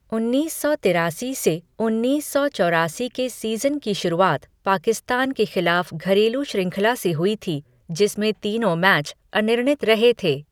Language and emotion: Hindi, neutral